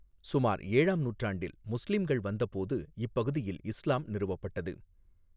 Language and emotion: Tamil, neutral